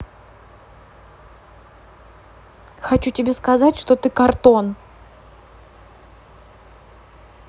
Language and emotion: Russian, neutral